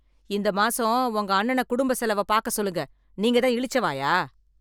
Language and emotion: Tamil, angry